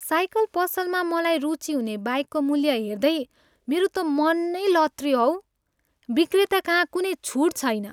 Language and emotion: Nepali, sad